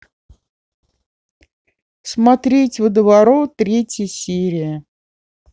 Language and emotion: Russian, neutral